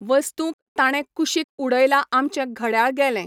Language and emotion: Goan Konkani, neutral